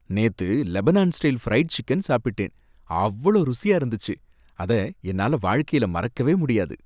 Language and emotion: Tamil, happy